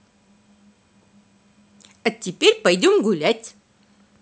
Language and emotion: Russian, positive